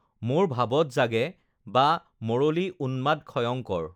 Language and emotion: Assamese, neutral